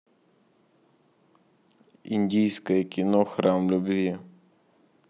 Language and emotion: Russian, neutral